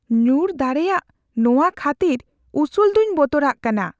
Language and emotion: Santali, fearful